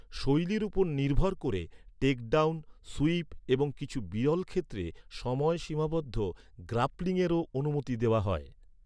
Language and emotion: Bengali, neutral